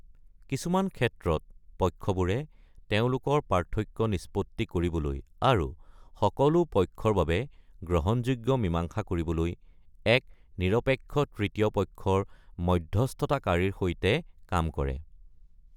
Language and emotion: Assamese, neutral